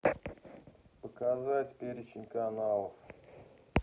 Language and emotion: Russian, neutral